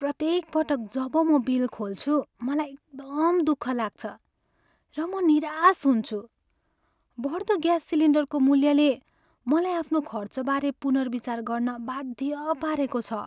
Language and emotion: Nepali, sad